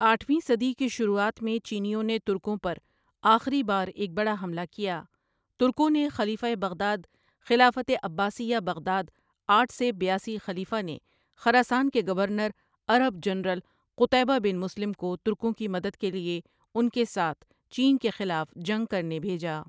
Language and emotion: Urdu, neutral